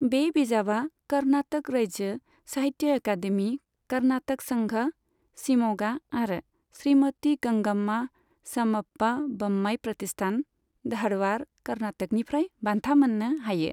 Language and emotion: Bodo, neutral